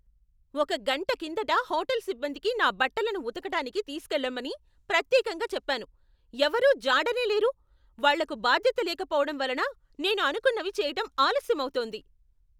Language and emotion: Telugu, angry